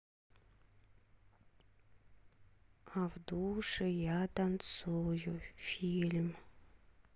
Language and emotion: Russian, sad